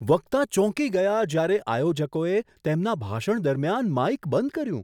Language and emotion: Gujarati, surprised